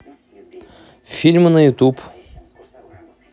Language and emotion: Russian, neutral